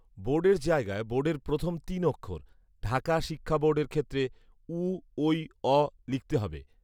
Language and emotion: Bengali, neutral